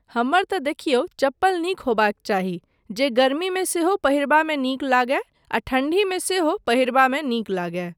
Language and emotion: Maithili, neutral